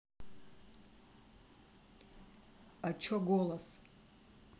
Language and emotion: Russian, neutral